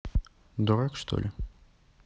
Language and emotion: Russian, neutral